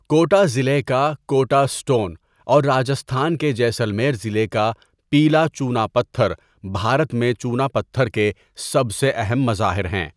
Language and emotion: Urdu, neutral